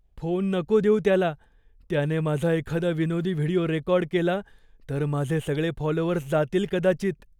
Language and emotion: Marathi, fearful